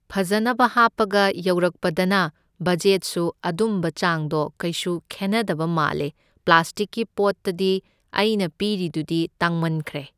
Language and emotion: Manipuri, neutral